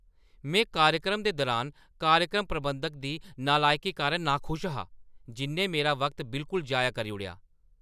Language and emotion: Dogri, angry